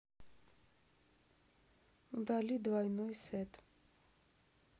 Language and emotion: Russian, neutral